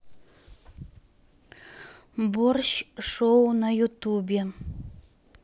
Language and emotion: Russian, neutral